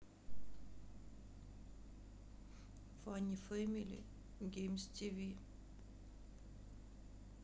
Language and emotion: Russian, sad